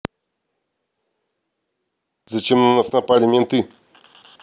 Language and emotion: Russian, angry